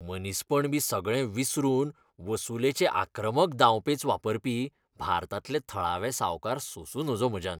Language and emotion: Goan Konkani, disgusted